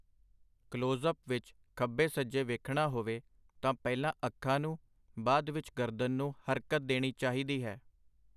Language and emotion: Punjabi, neutral